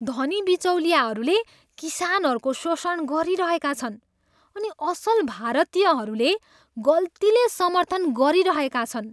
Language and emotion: Nepali, disgusted